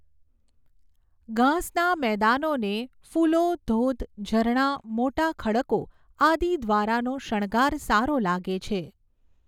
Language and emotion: Gujarati, neutral